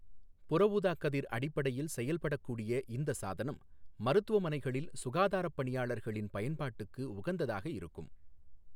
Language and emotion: Tamil, neutral